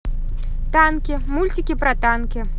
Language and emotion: Russian, positive